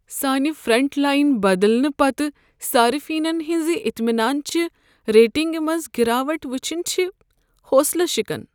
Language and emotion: Kashmiri, sad